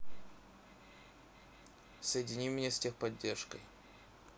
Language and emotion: Russian, neutral